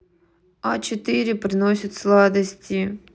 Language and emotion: Russian, neutral